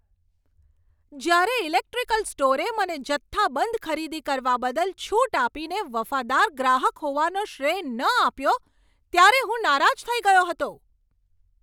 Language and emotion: Gujarati, angry